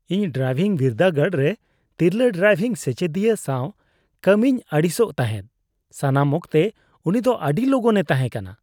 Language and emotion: Santali, disgusted